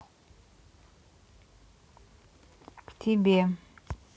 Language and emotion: Russian, neutral